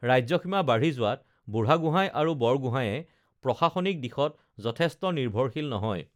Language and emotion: Assamese, neutral